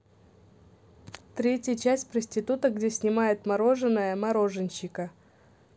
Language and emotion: Russian, neutral